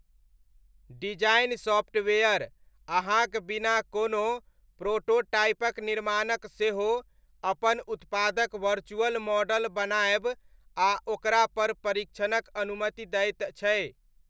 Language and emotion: Maithili, neutral